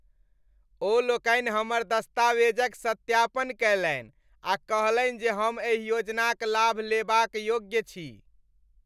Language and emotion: Maithili, happy